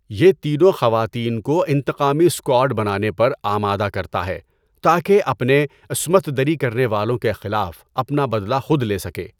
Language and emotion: Urdu, neutral